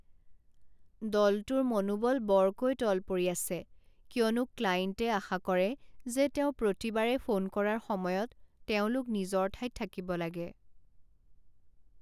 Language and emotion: Assamese, sad